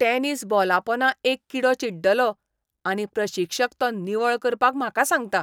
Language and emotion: Goan Konkani, disgusted